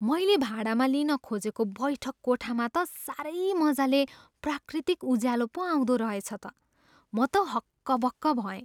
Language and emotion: Nepali, surprised